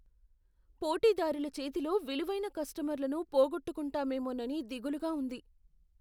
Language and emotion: Telugu, fearful